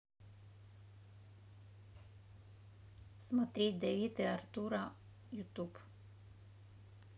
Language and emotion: Russian, neutral